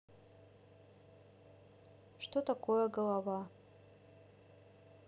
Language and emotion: Russian, neutral